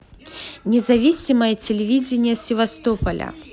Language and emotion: Russian, positive